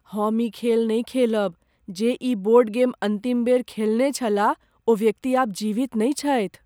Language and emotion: Maithili, fearful